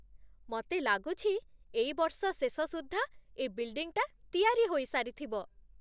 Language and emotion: Odia, happy